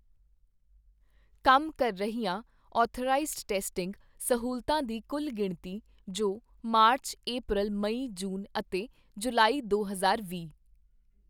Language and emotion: Punjabi, neutral